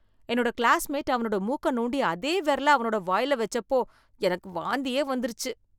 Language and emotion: Tamil, disgusted